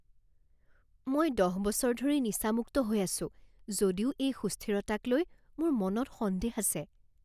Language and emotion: Assamese, fearful